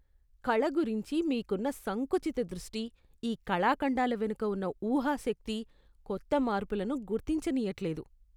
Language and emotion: Telugu, disgusted